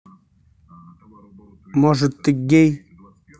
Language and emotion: Russian, angry